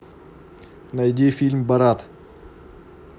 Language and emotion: Russian, neutral